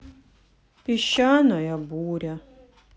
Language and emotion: Russian, sad